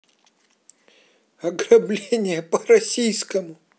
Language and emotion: Russian, sad